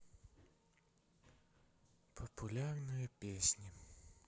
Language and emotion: Russian, sad